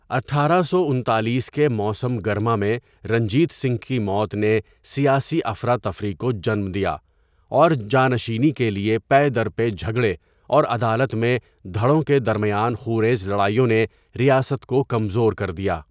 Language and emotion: Urdu, neutral